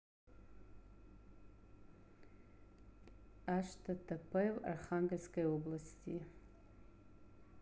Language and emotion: Russian, neutral